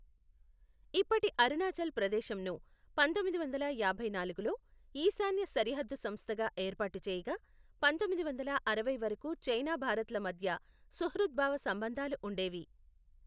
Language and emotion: Telugu, neutral